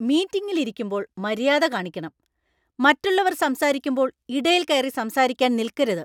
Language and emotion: Malayalam, angry